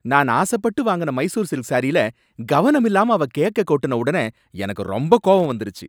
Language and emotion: Tamil, angry